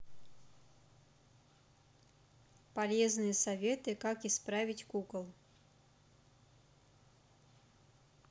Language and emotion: Russian, neutral